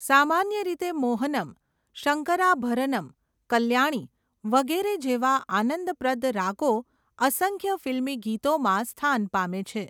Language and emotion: Gujarati, neutral